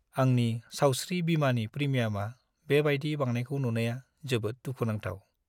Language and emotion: Bodo, sad